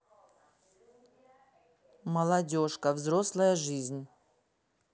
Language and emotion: Russian, neutral